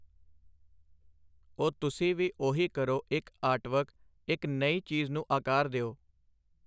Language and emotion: Punjabi, neutral